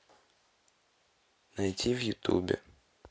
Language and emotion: Russian, neutral